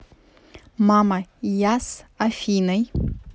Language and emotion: Russian, neutral